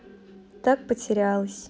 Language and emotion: Russian, neutral